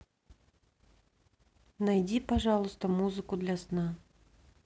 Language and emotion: Russian, neutral